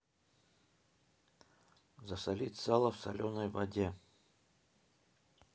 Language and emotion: Russian, neutral